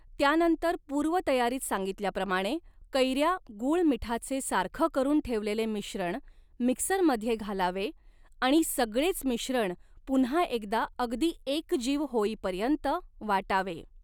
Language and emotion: Marathi, neutral